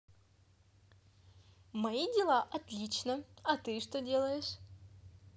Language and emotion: Russian, positive